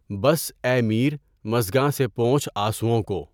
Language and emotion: Urdu, neutral